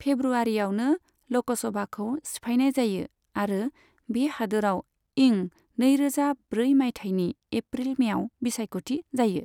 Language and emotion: Bodo, neutral